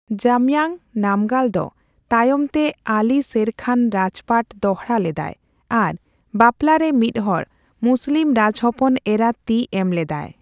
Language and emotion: Santali, neutral